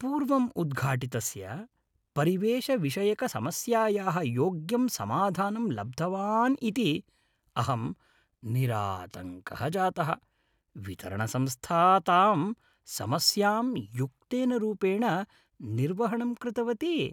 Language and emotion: Sanskrit, happy